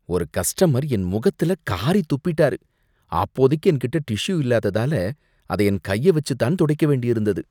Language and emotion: Tamil, disgusted